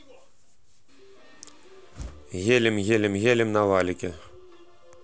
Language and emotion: Russian, neutral